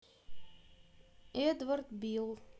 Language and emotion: Russian, neutral